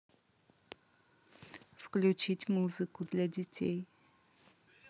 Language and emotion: Russian, neutral